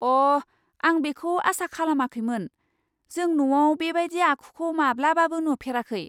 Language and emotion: Bodo, surprised